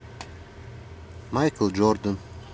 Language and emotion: Russian, neutral